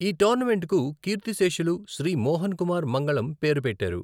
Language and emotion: Telugu, neutral